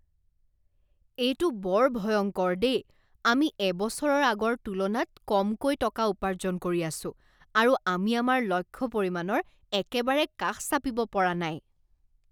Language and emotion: Assamese, disgusted